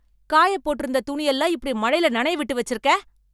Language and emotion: Tamil, angry